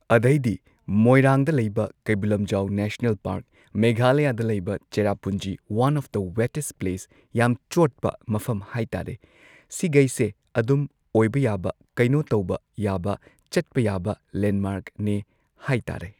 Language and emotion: Manipuri, neutral